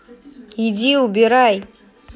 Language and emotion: Russian, angry